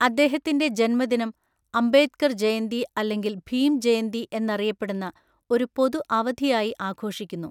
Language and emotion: Malayalam, neutral